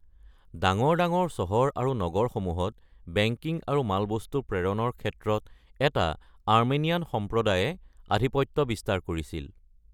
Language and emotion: Assamese, neutral